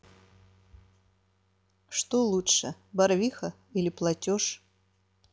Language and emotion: Russian, neutral